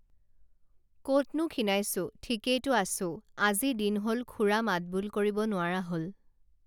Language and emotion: Assamese, neutral